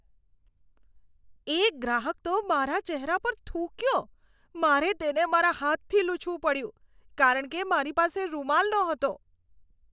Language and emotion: Gujarati, disgusted